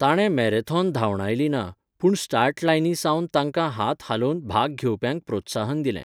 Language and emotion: Goan Konkani, neutral